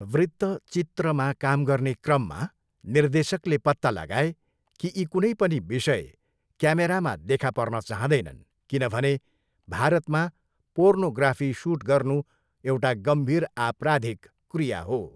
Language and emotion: Nepali, neutral